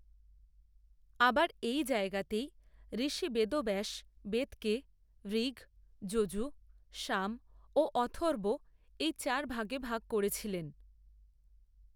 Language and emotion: Bengali, neutral